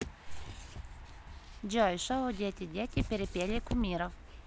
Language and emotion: Russian, neutral